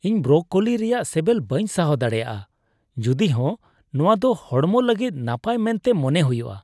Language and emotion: Santali, disgusted